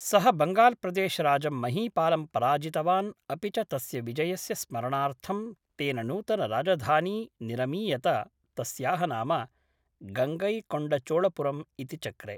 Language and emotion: Sanskrit, neutral